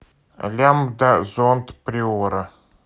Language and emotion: Russian, neutral